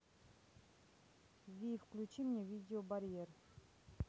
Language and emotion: Russian, neutral